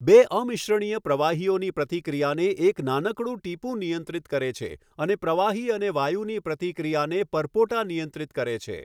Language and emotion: Gujarati, neutral